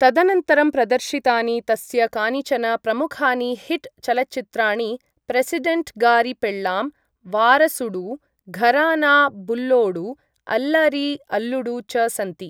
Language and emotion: Sanskrit, neutral